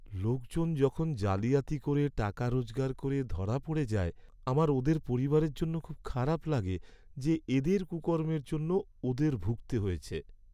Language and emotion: Bengali, sad